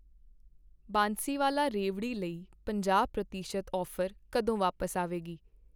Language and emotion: Punjabi, neutral